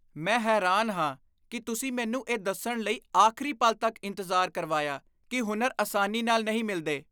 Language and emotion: Punjabi, disgusted